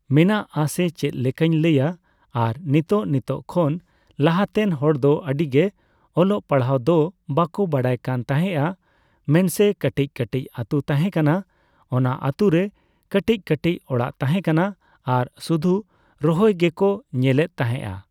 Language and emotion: Santali, neutral